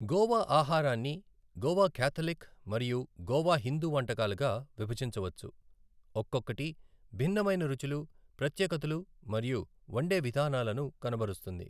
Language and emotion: Telugu, neutral